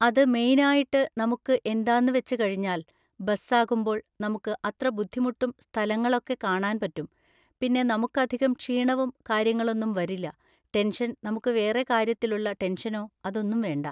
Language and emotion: Malayalam, neutral